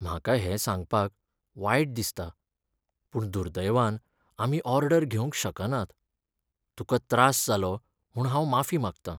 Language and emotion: Goan Konkani, sad